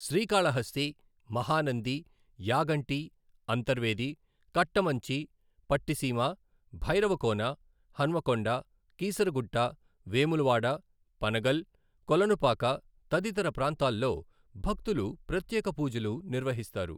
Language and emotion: Telugu, neutral